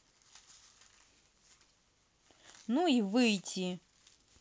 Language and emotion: Russian, angry